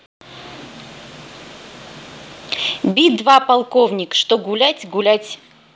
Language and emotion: Russian, neutral